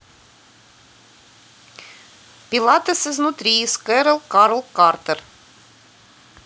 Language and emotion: Russian, neutral